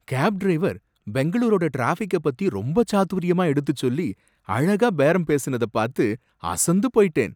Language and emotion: Tamil, surprised